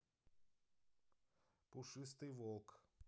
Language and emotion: Russian, neutral